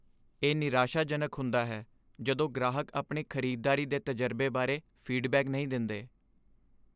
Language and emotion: Punjabi, sad